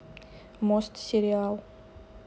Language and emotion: Russian, neutral